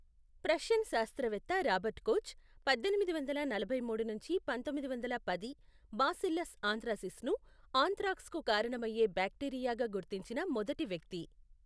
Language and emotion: Telugu, neutral